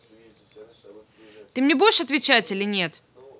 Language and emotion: Russian, angry